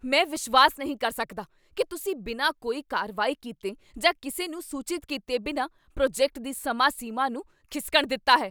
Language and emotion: Punjabi, angry